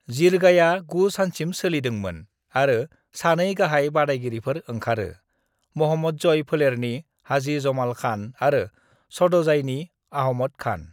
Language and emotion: Bodo, neutral